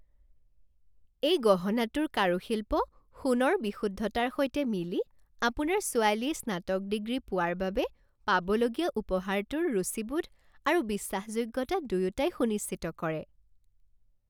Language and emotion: Assamese, happy